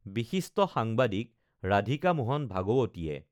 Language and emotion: Assamese, neutral